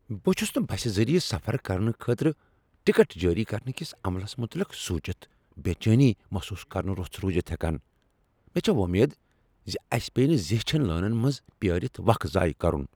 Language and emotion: Kashmiri, fearful